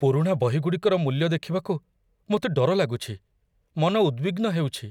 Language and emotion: Odia, fearful